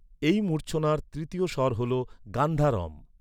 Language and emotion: Bengali, neutral